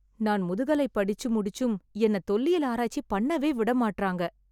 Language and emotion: Tamil, sad